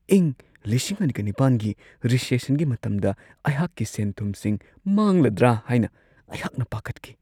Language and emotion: Manipuri, fearful